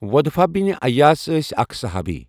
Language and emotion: Kashmiri, neutral